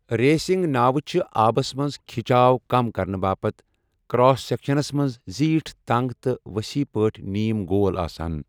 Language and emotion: Kashmiri, neutral